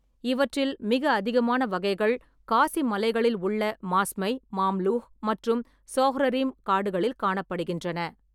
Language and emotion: Tamil, neutral